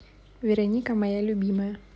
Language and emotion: Russian, neutral